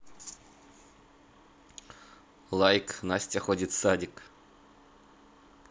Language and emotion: Russian, neutral